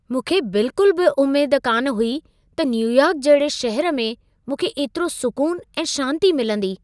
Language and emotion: Sindhi, surprised